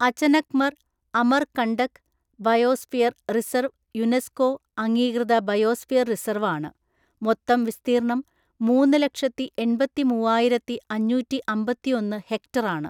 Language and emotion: Malayalam, neutral